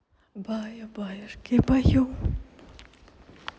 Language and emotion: Russian, neutral